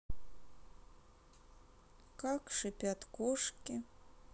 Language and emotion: Russian, sad